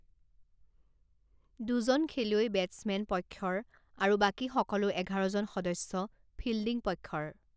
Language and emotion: Assamese, neutral